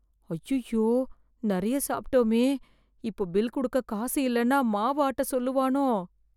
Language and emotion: Tamil, fearful